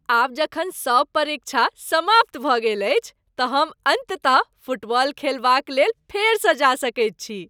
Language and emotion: Maithili, happy